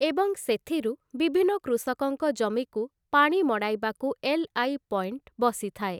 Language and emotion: Odia, neutral